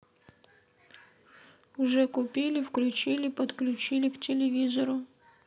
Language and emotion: Russian, neutral